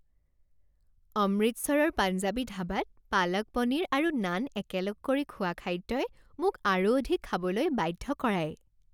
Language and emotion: Assamese, happy